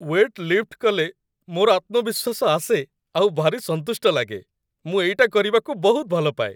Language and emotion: Odia, happy